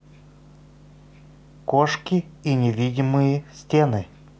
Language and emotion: Russian, neutral